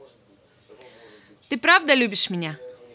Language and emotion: Russian, positive